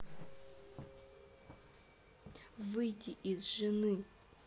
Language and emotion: Russian, angry